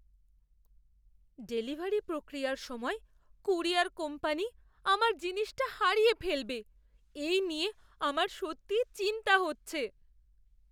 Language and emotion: Bengali, fearful